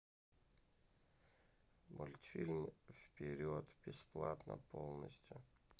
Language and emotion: Russian, neutral